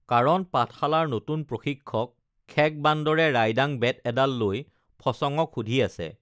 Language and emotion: Assamese, neutral